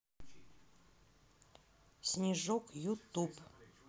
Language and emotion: Russian, neutral